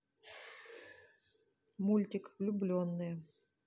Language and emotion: Russian, neutral